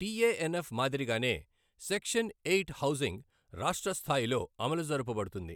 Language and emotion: Telugu, neutral